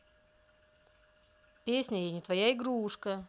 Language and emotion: Russian, neutral